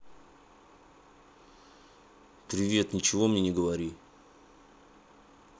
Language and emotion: Russian, angry